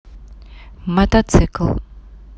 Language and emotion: Russian, neutral